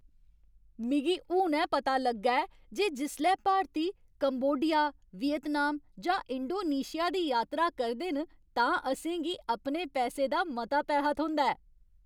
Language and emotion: Dogri, happy